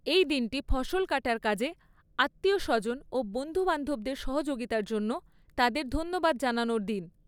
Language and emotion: Bengali, neutral